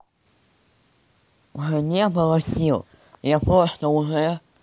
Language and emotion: Russian, neutral